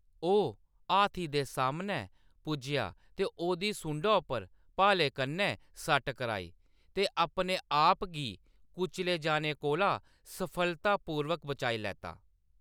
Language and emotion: Dogri, neutral